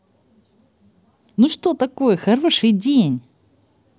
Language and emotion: Russian, positive